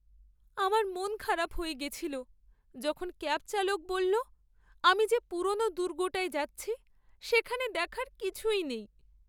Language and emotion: Bengali, sad